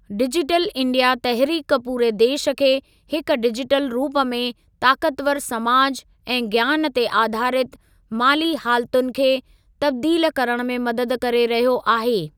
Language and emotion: Sindhi, neutral